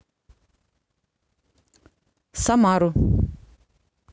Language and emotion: Russian, neutral